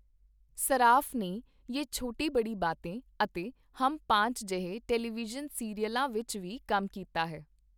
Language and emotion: Punjabi, neutral